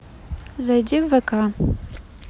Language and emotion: Russian, neutral